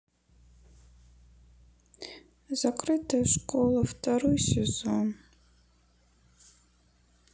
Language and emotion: Russian, sad